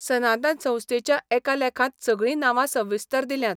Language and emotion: Goan Konkani, neutral